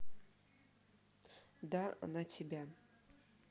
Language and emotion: Russian, neutral